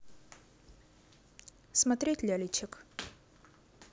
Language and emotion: Russian, neutral